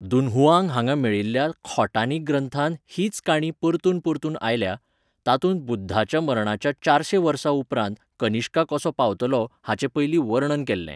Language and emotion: Goan Konkani, neutral